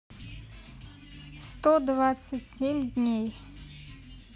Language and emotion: Russian, neutral